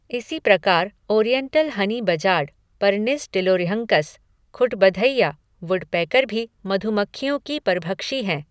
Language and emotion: Hindi, neutral